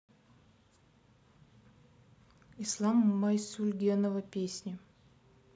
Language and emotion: Russian, neutral